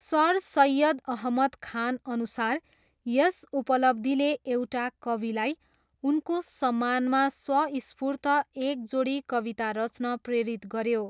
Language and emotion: Nepali, neutral